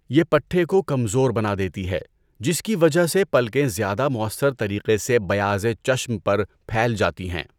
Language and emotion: Urdu, neutral